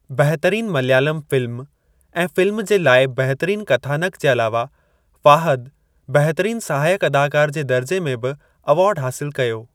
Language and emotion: Sindhi, neutral